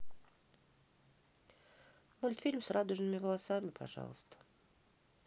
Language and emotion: Russian, sad